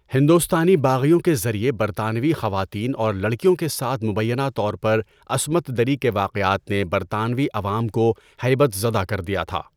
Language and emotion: Urdu, neutral